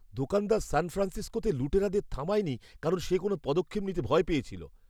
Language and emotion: Bengali, fearful